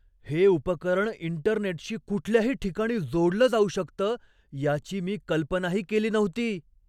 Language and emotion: Marathi, surprised